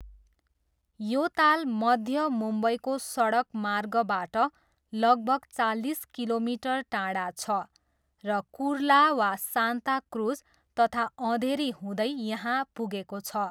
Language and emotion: Nepali, neutral